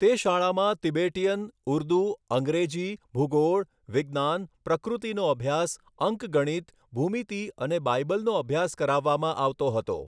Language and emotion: Gujarati, neutral